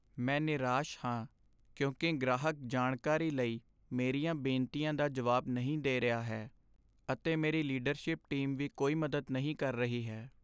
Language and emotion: Punjabi, sad